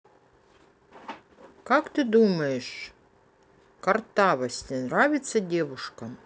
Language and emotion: Russian, neutral